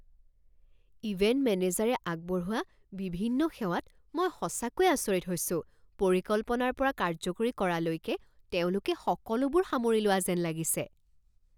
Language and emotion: Assamese, surprised